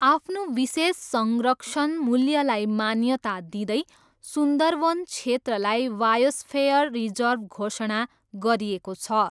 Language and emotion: Nepali, neutral